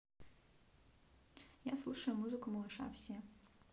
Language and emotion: Russian, neutral